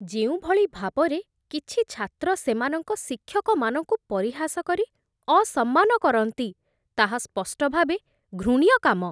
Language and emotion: Odia, disgusted